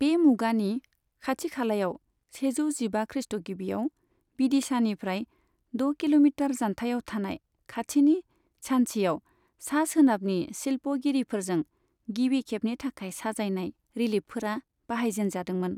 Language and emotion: Bodo, neutral